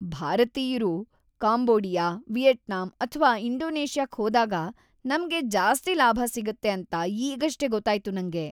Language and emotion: Kannada, happy